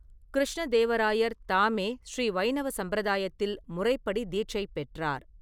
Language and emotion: Tamil, neutral